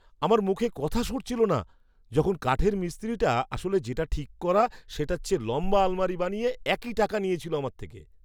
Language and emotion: Bengali, surprised